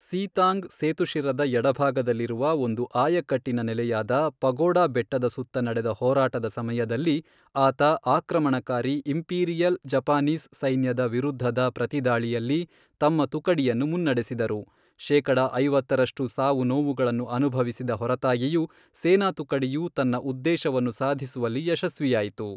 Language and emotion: Kannada, neutral